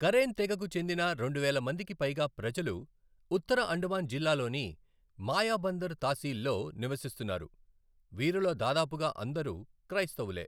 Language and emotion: Telugu, neutral